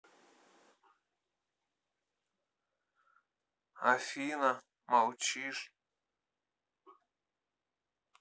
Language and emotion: Russian, sad